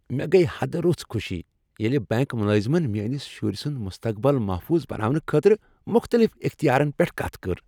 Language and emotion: Kashmiri, happy